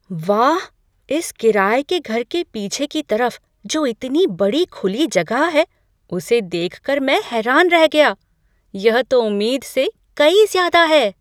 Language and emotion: Hindi, surprised